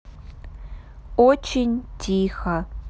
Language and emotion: Russian, neutral